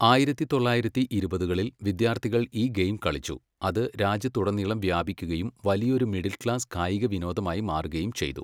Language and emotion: Malayalam, neutral